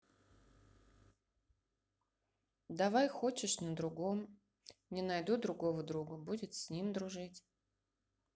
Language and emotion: Russian, neutral